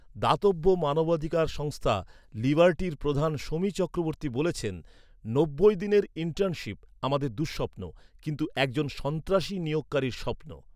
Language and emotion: Bengali, neutral